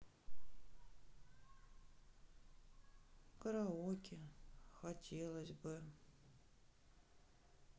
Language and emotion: Russian, sad